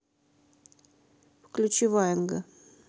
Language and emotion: Russian, neutral